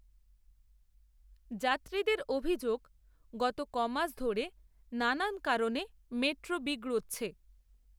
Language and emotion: Bengali, neutral